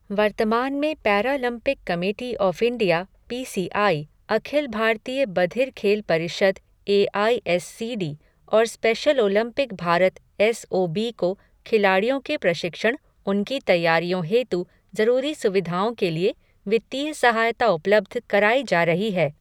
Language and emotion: Hindi, neutral